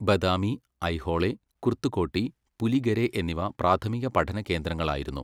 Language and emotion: Malayalam, neutral